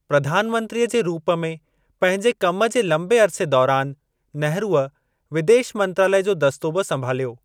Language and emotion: Sindhi, neutral